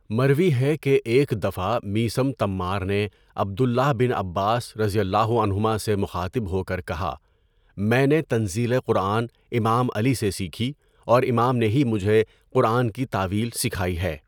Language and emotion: Urdu, neutral